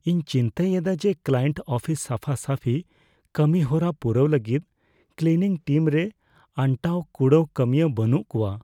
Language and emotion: Santali, fearful